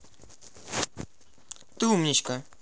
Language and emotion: Russian, positive